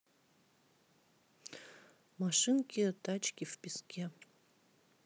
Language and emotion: Russian, neutral